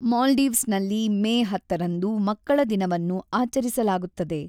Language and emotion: Kannada, neutral